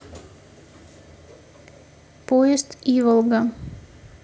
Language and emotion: Russian, neutral